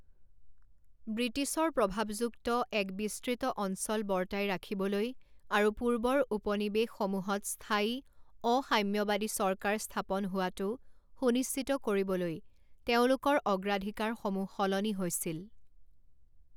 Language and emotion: Assamese, neutral